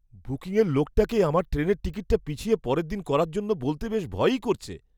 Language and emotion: Bengali, fearful